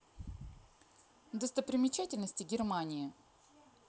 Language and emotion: Russian, neutral